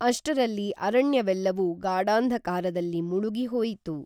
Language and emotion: Kannada, neutral